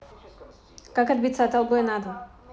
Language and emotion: Russian, neutral